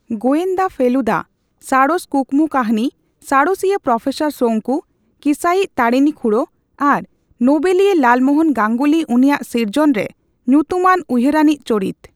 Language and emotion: Santali, neutral